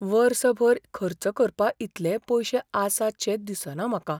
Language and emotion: Goan Konkani, fearful